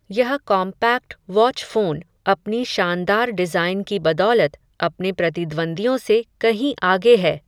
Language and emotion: Hindi, neutral